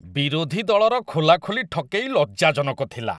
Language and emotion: Odia, disgusted